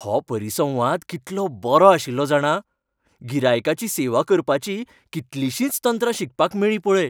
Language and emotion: Goan Konkani, happy